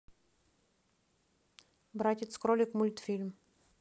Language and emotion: Russian, neutral